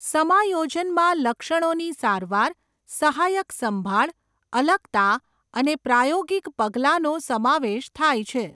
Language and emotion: Gujarati, neutral